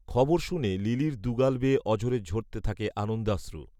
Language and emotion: Bengali, neutral